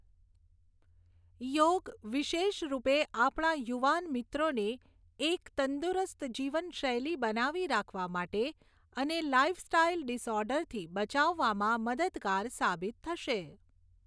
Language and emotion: Gujarati, neutral